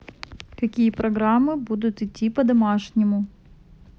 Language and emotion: Russian, neutral